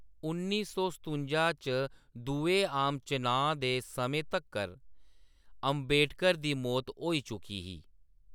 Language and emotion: Dogri, neutral